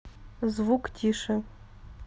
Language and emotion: Russian, neutral